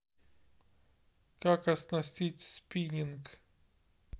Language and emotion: Russian, neutral